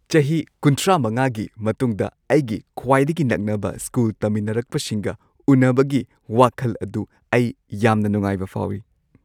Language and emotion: Manipuri, happy